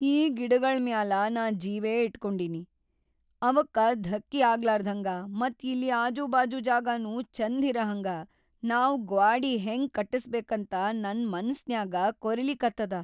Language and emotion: Kannada, fearful